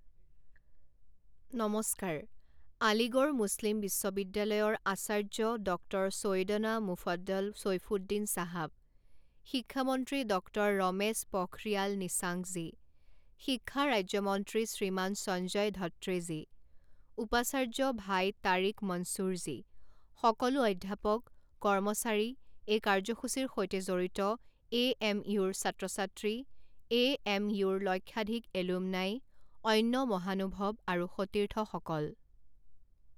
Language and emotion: Assamese, neutral